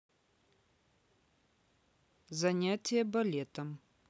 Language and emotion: Russian, neutral